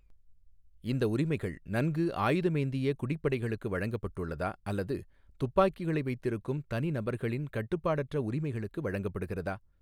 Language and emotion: Tamil, neutral